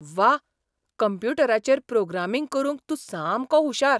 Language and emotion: Goan Konkani, surprised